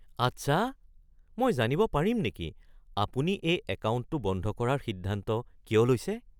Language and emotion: Assamese, surprised